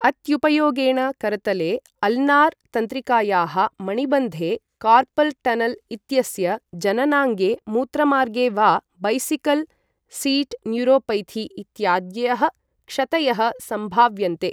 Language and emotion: Sanskrit, neutral